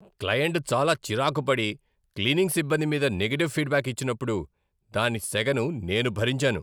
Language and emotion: Telugu, angry